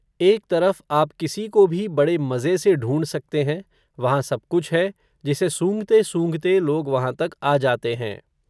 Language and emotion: Hindi, neutral